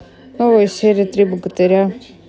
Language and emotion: Russian, neutral